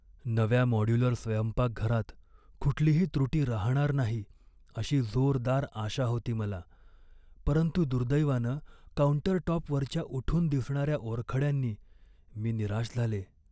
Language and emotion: Marathi, sad